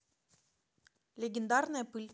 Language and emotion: Russian, neutral